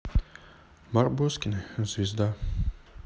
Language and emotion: Russian, sad